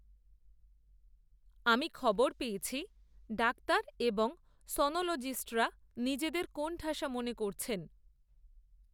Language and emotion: Bengali, neutral